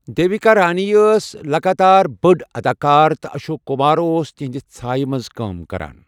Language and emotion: Kashmiri, neutral